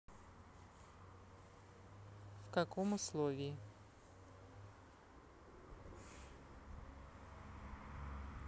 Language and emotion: Russian, neutral